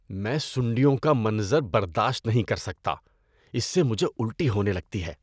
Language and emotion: Urdu, disgusted